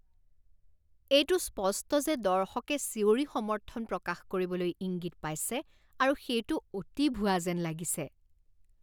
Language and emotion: Assamese, disgusted